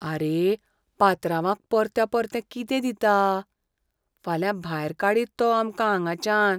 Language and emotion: Goan Konkani, fearful